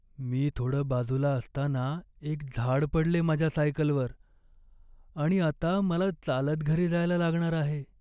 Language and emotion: Marathi, sad